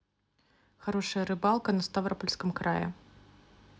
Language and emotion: Russian, neutral